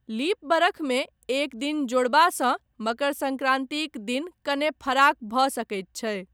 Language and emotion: Maithili, neutral